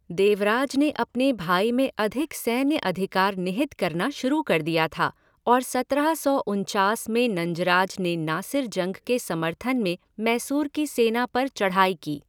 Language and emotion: Hindi, neutral